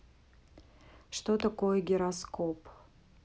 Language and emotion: Russian, neutral